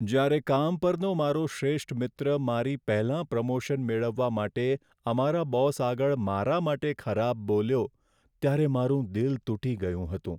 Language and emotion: Gujarati, sad